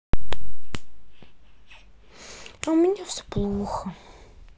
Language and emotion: Russian, sad